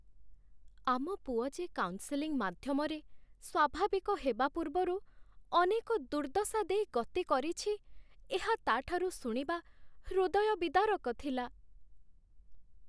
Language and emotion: Odia, sad